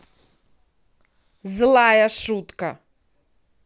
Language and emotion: Russian, angry